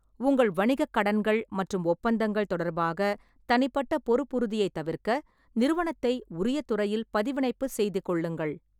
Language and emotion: Tamil, neutral